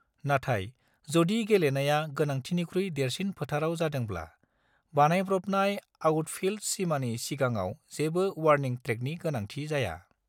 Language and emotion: Bodo, neutral